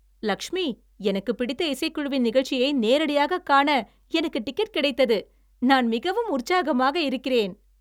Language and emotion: Tamil, happy